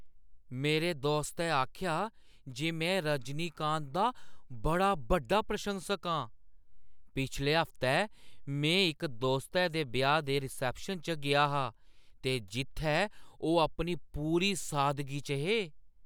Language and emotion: Dogri, surprised